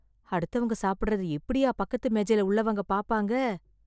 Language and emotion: Tamil, disgusted